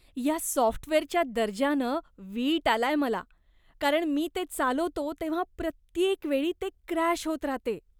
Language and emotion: Marathi, disgusted